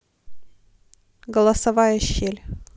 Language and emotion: Russian, neutral